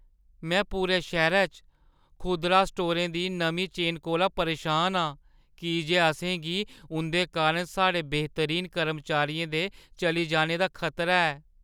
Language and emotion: Dogri, fearful